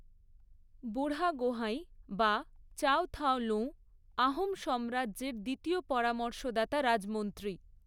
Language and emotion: Bengali, neutral